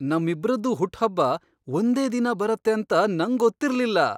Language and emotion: Kannada, surprised